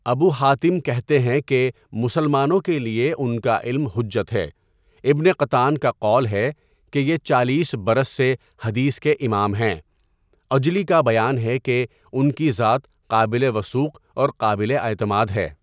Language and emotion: Urdu, neutral